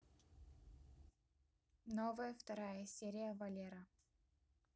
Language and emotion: Russian, positive